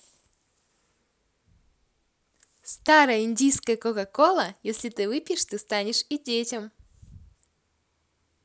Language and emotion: Russian, positive